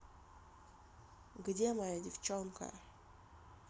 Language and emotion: Russian, sad